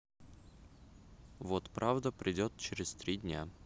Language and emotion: Russian, neutral